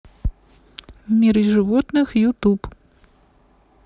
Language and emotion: Russian, neutral